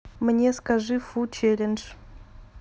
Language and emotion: Russian, neutral